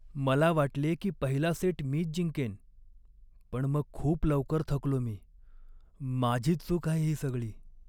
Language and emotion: Marathi, sad